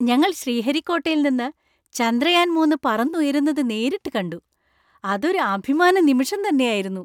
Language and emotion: Malayalam, happy